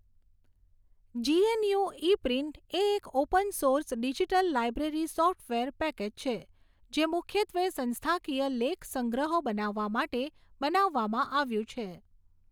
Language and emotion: Gujarati, neutral